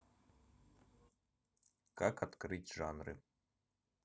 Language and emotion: Russian, neutral